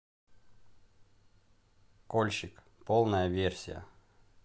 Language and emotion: Russian, neutral